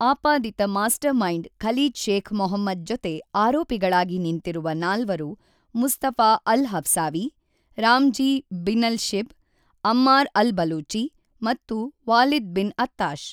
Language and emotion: Kannada, neutral